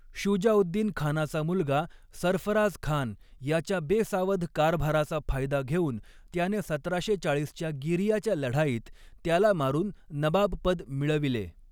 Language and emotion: Marathi, neutral